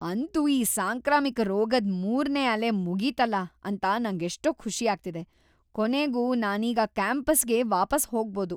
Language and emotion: Kannada, happy